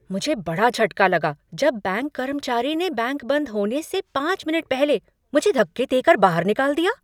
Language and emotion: Hindi, surprised